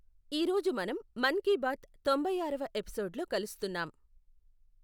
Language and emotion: Telugu, neutral